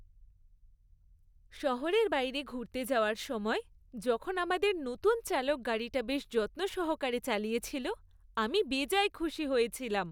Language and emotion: Bengali, happy